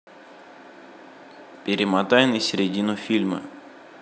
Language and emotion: Russian, neutral